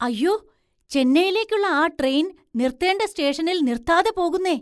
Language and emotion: Malayalam, surprised